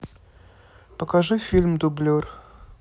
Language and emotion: Russian, neutral